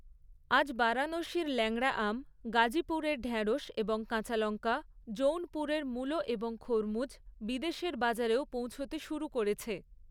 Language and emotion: Bengali, neutral